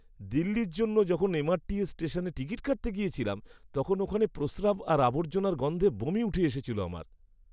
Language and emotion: Bengali, disgusted